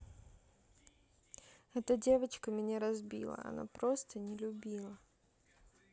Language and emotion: Russian, sad